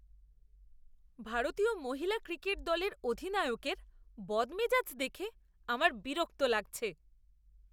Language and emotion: Bengali, disgusted